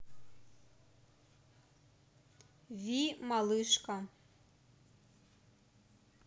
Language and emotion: Russian, neutral